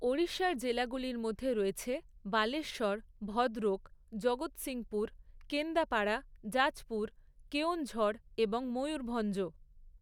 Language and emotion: Bengali, neutral